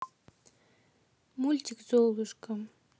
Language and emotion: Russian, neutral